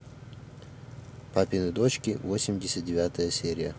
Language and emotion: Russian, neutral